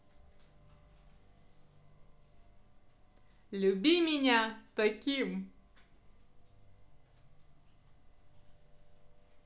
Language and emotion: Russian, positive